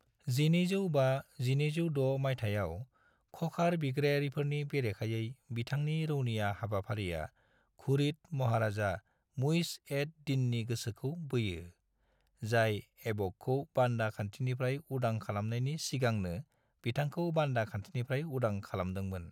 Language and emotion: Bodo, neutral